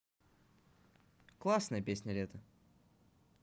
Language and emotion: Russian, positive